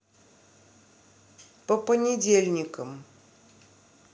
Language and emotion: Russian, neutral